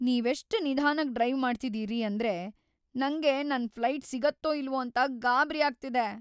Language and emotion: Kannada, fearful